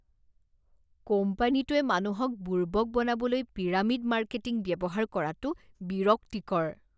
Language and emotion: Assamese, disgusted